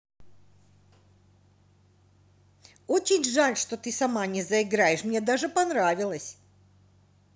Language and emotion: Russian, angry